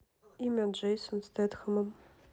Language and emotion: Russian, neutral